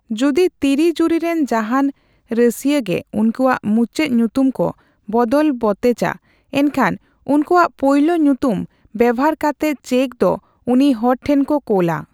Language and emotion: Santali, neutral